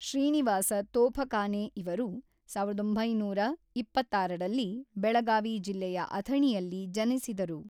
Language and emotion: Kannada, neutral